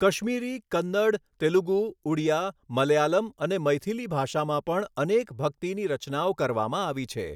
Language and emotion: Gujarati, neutral